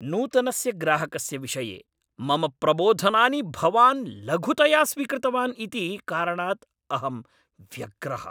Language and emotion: Sanskrit, angry